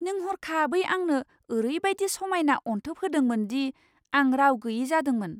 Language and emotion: Bodo, surprised